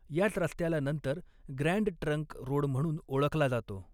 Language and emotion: Marathi, neutral